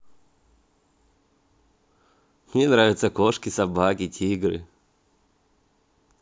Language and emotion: Russian, positive